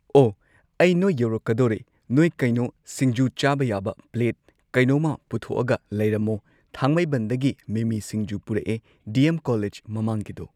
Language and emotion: Manipuri, neutral